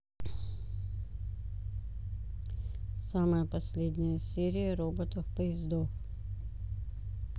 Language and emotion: Russian, neutral